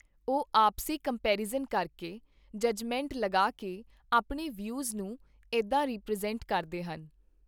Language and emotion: Punjabi, neutral